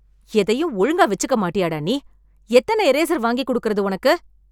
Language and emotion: Tamil, angry